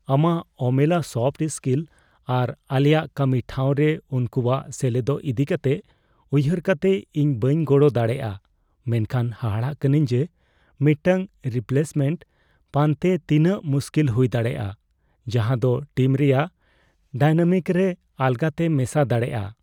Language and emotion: Santali, fearful